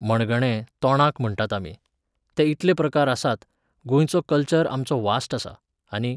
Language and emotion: Goan Konkani, neutral